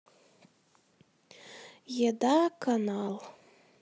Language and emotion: Russian, sad